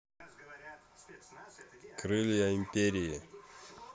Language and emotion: Russian, neutral